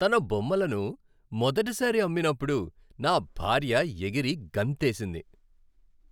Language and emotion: Telugu, happy